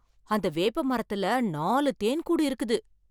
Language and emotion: Tamil, surprised